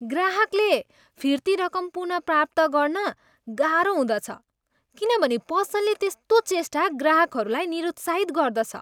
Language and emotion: Nepali, disgusted